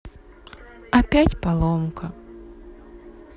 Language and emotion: Russian, sad